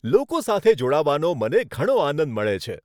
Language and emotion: Gujarati, happy